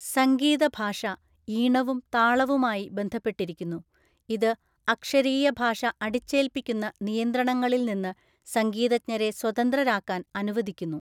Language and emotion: Malayalam, neutral